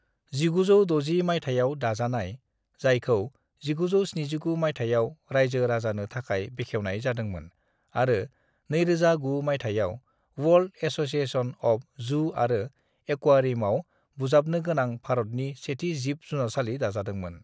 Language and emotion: Bodo, neutral